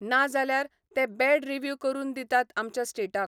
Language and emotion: Goan Konkani, neutral